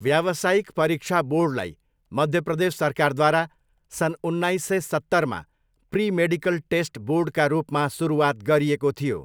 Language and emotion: Nepali, neutral